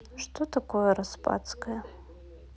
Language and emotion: Russian, neutral